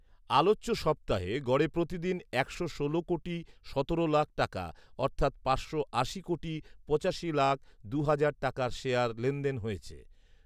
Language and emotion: Bengali, neutral